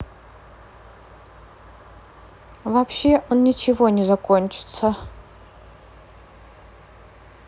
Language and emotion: Russian, neutral